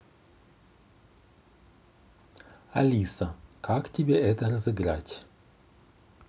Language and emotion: Russian, neutral